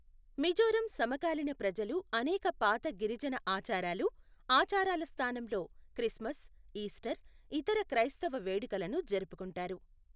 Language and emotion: Telugu, neutral